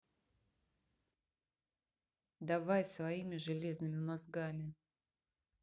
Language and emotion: Russian, neutral